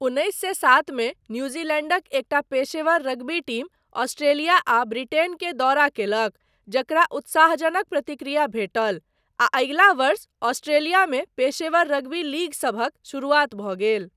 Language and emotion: Maithili, neutral